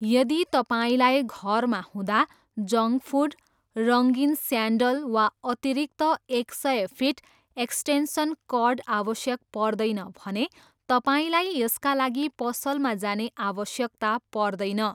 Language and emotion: Nepali, neutral